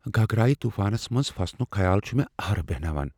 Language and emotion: Kashmiri, fearful